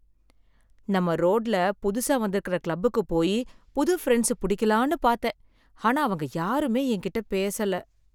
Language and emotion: Tamil, sad